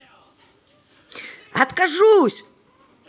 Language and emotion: Russian, neutral